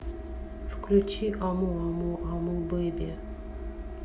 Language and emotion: Russian, neutral